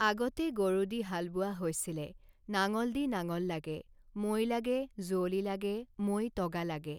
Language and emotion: Assamese, neutral